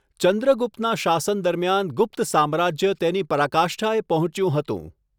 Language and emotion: Gujarati, neutral